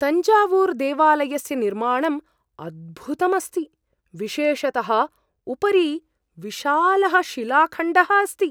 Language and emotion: Sanskrit, surprised